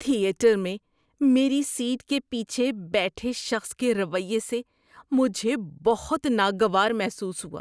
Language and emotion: Urdu, disgusted